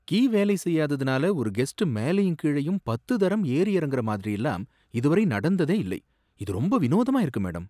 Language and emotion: Tamil, surprised